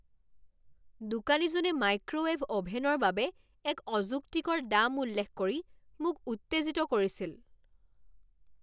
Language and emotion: Assamese, angry